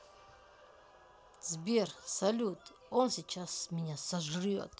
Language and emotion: Russian, angry